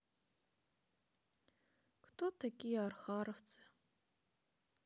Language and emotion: Russian, sad